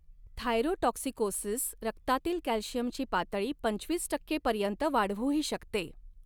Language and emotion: Marathi, neutral